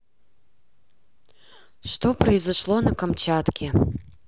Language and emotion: Russian, neutral